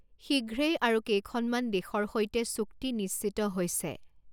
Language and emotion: Assamese, neutral